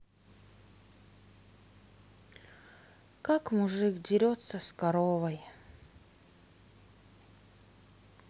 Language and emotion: Russian, sad